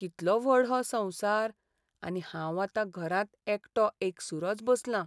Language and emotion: Goan Konkani, sad